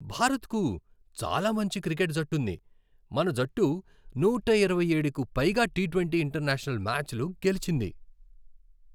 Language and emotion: Telugu, happy